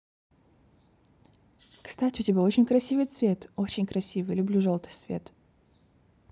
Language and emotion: Russian, positive